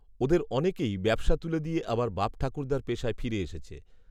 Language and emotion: Bengali, neutral